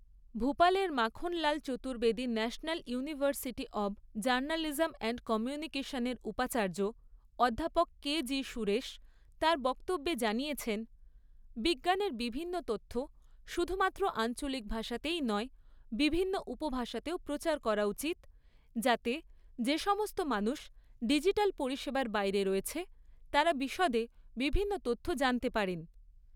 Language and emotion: Bengali, neutral